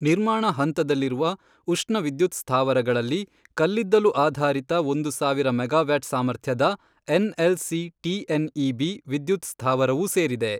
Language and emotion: Kannada, neutral